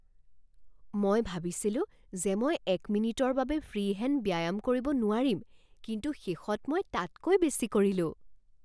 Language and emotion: Assamese, surprised